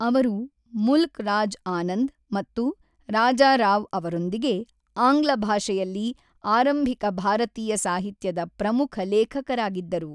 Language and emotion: Kannada, neutral